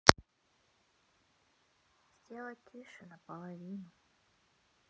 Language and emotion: Russian, sad